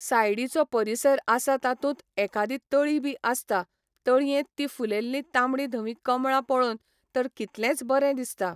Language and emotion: Goan Konkani, neutral